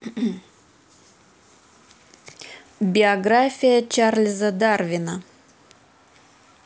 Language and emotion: Russian, neutral